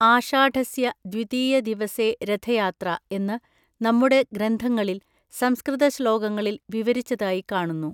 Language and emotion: Malayalam, neutral